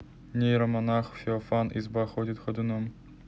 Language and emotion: Russian, neutral